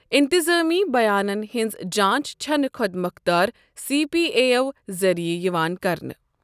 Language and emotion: Kashmiri, neutral